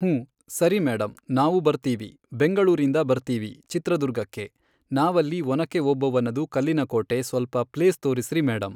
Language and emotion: Kannada, neutral